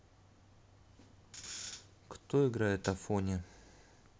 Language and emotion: Russian, neutral